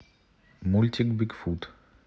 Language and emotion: Russian, neutral